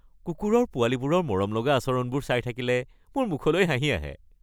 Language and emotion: Assamese, happy